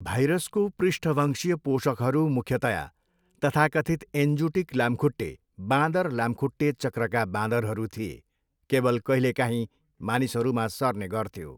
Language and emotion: Nepali, neutral